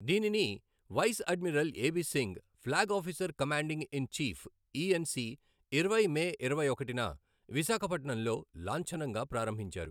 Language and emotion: Telugu, neutral